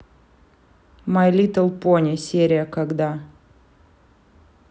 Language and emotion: Russian, neutral